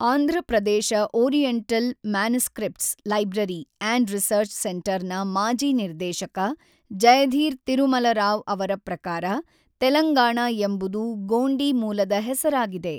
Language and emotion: Kannada, neutral